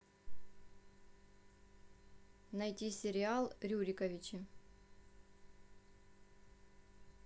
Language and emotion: Russian, neutral